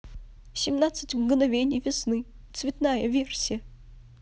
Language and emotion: Russian, sad